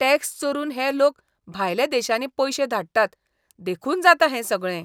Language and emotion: Goan Konkani, disgusted